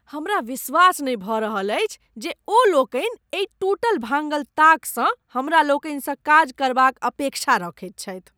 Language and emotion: Maithili, disgusted